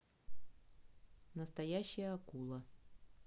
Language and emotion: Russian, neutral